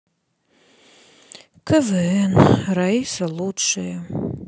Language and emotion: Russian, sad